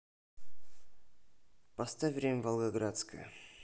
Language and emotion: Russian, neutral